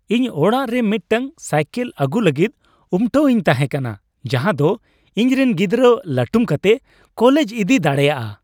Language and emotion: Santali, happy